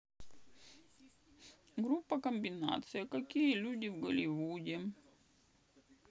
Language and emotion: Russian, sad